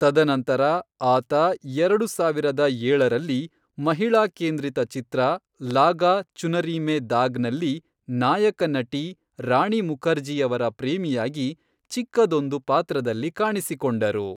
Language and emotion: Kannada, neutral